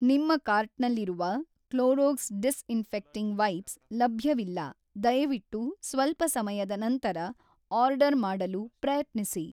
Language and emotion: Kannada, neutral